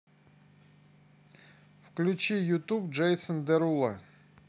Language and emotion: Russian, neutral